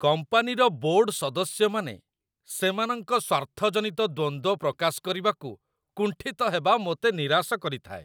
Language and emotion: Odia, disgusted